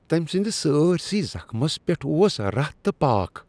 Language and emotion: Kashmiri, disgusted